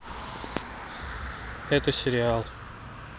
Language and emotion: Russian, neutral